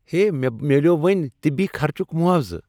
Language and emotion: Kashmiri, happy